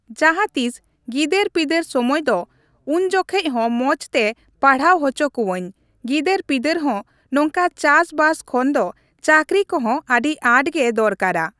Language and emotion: Santali, neutral